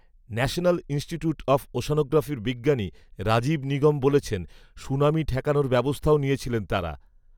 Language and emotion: Bengali, neutral